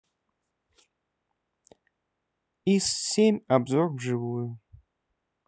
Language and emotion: Russian, neutral